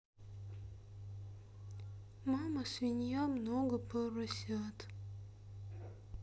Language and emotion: Russian, sad